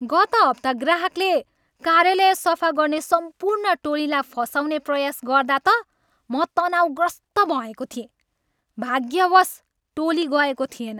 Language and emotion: Nepali, angry